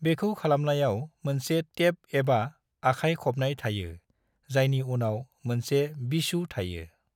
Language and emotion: Bodo, neutral